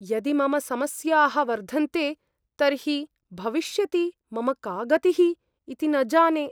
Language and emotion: Sanskrit, fearful